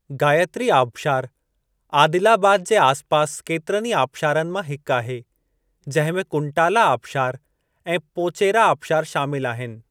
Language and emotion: Sindhi, neutral